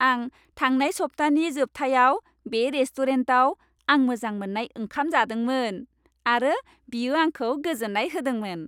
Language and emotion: Bodo, happy